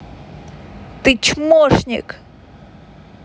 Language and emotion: Russian, angry